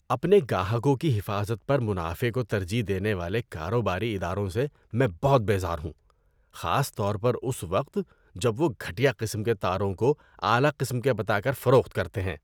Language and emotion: Urdu, disgusted